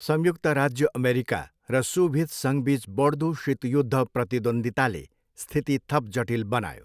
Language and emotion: Nepali, neutral